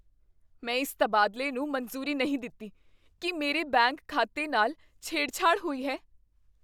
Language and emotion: Punjabi, fearful